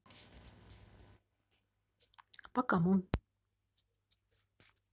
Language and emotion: Russian, neutral